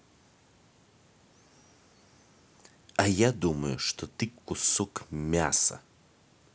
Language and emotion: Russian, angry